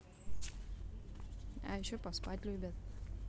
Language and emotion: Russian, neutral